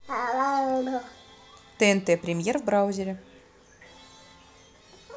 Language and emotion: Russian, neutral